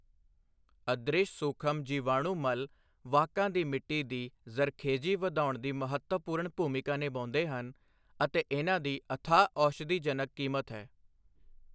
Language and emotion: Punjabi, neutral